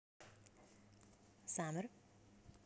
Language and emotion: Russian, neutral